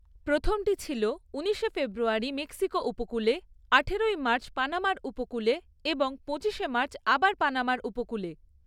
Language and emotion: Bengali, neutral